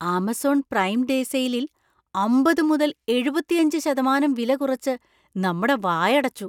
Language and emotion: Malayalam, surprised